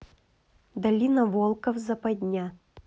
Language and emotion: Russian, neutral